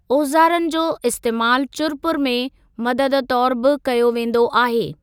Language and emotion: Sindhi, neutral